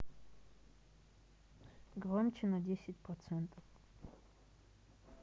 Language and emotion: Russian, neutral